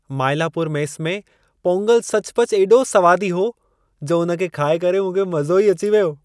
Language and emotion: Sindhi, happy